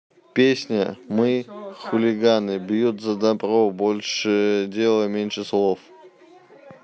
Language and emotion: Russian, neutral